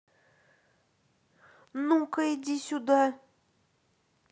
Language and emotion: Russian, angry